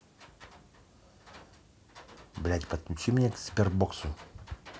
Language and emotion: Russian, angry